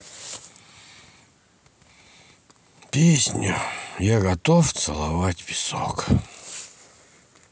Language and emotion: Russian, sad